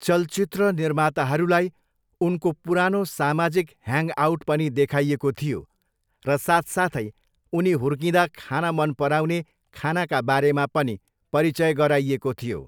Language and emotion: Nepali, neutral